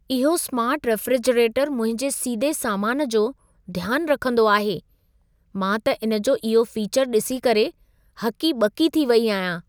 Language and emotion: Sindhi, surprised